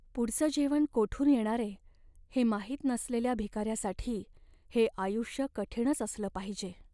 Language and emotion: Marathi, sad